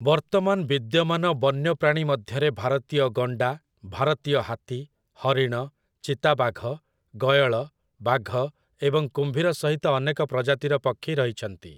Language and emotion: Odia, neutral